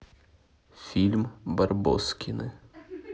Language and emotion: Russian, neutral